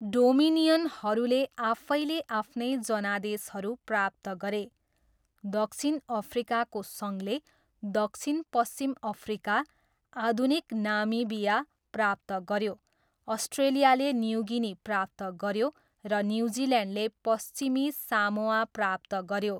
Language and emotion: Nepali, neutral